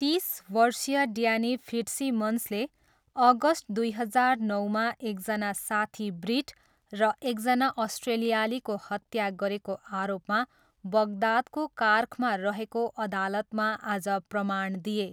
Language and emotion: Nepali, neutral